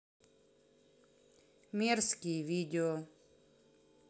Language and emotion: Russian, neutral